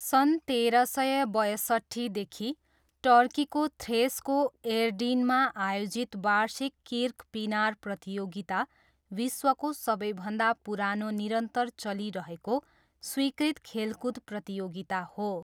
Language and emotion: Nepali, neutral